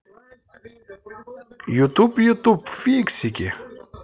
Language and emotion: Russian, positive